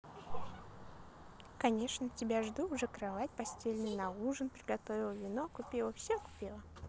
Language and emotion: Russian, positive